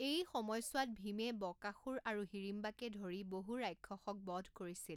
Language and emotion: Assamese, neutral